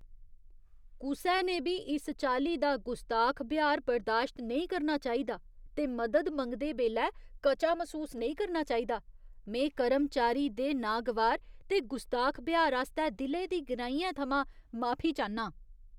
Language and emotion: Dogri, disgusted